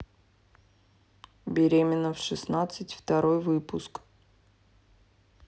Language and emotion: Russian, neutral